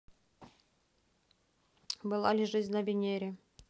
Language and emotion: Russian, neutral